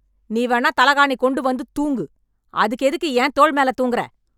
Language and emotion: Tamil, angry